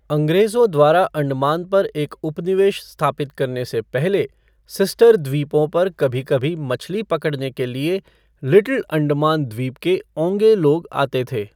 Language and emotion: Hindi, neutral